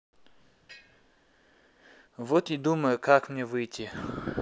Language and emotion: Russian, neutral